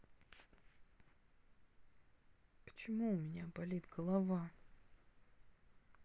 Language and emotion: Russian, sad